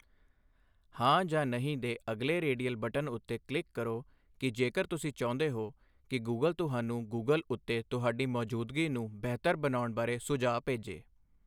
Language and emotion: Punjabi, neutral